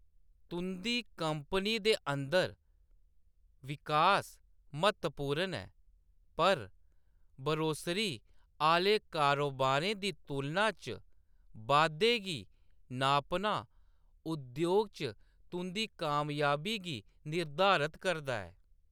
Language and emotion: Dogri, neutral